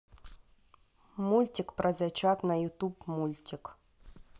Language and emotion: Russian, neutral